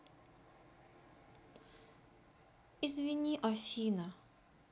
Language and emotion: Russian, sad